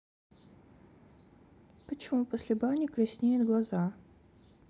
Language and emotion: Russian, neutral